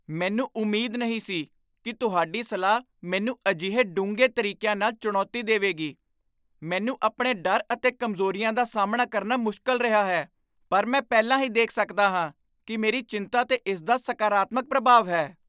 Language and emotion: Punjabi, surprised